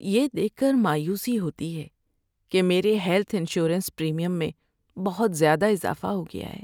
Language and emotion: Urdu, sad